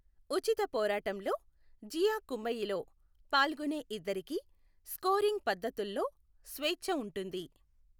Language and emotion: Telugu, neutral